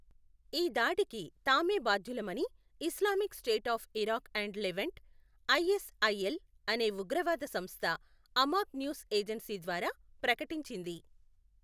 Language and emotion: Telugu, neutral